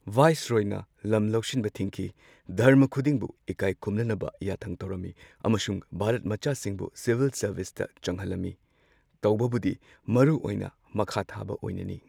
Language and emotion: Manipuri, neutral